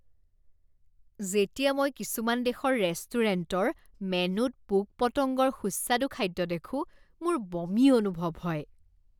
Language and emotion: Assamese, disgusted